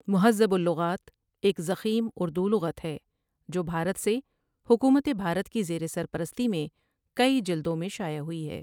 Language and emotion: Urdu, neutral